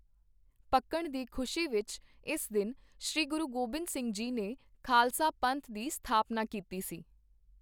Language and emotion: Punjabi, neutral